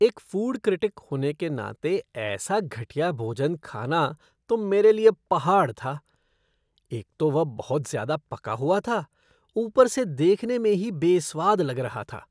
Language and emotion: Hindi, disgusted